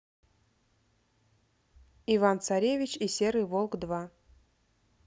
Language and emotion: Russian, neutral